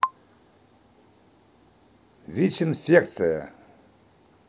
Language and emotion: Russian, neutral